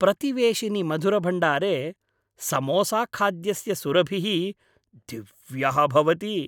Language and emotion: Sanskrit, happy